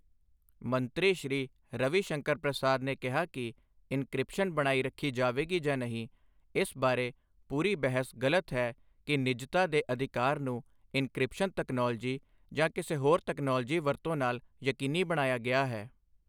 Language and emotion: Punjabi, neutral